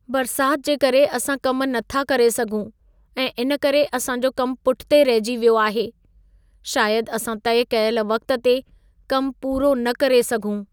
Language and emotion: Sindhi, sad